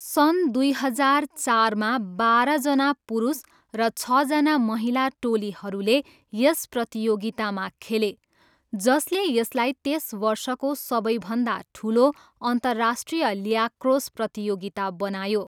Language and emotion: Nepali, neutral